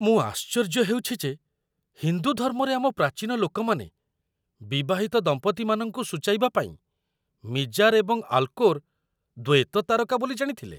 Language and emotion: Odia, surprised